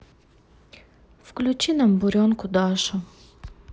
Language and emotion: Russian, sad